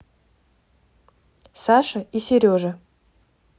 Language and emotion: Russian, neutral